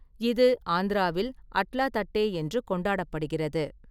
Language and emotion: Tamil, neutral